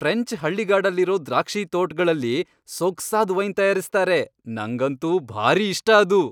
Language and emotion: Kannada, happy